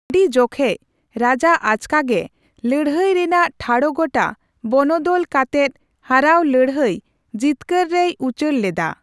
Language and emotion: Santali, neutral